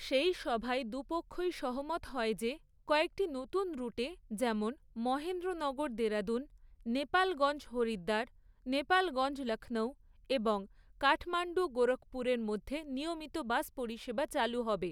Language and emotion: Bengali, neutral